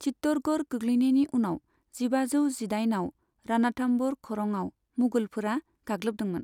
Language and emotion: Bodo, neutral